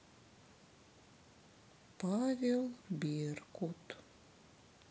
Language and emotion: Russian, sad